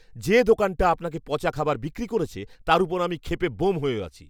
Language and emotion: Bengali, angry